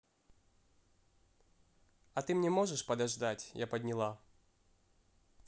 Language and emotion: Russian, neutral